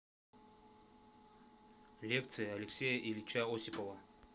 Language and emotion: Russian, neutral